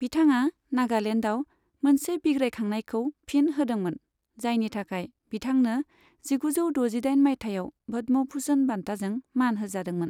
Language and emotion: Bodo, neutral